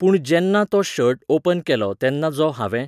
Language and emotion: Goan Konkani, neutral